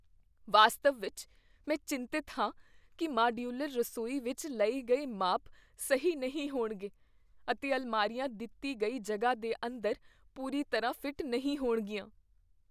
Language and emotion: Punjabi, fearful